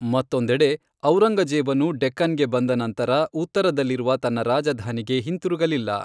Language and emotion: Kannada, neutral